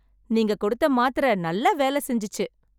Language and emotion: Tamil, happy